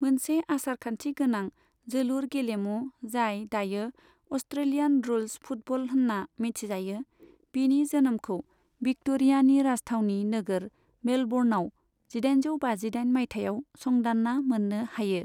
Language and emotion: Bodo, neutral